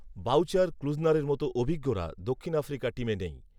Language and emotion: Bengali, neutral